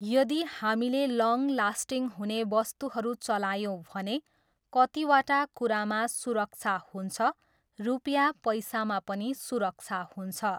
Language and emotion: Nepali, neutral